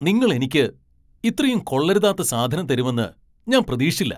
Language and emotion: Malayalam, angry